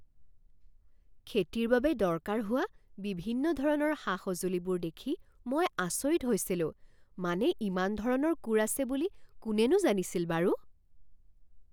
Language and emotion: Assamese, surprised